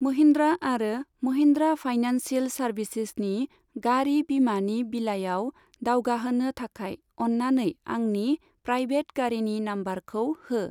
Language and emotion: Bodo, neutral